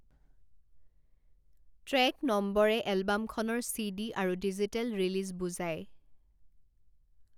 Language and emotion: Assamese, neutral